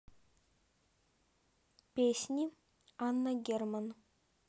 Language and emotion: Russian, neutral